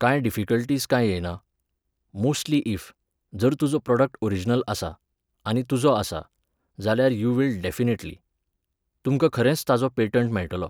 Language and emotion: Goan Konkani, neutral